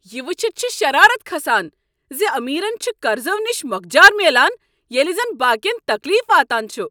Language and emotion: Kashmiri, angry